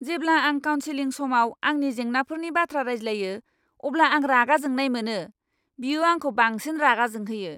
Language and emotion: Bodo, angry